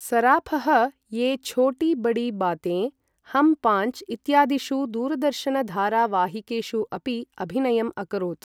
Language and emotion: Sanskrit, neutral